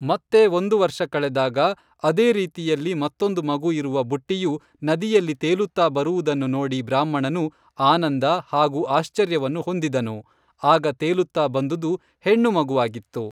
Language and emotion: Kannada, neutral